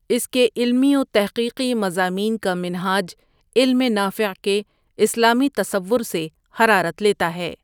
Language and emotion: Urdu, neutral